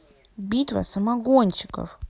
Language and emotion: Russian, angry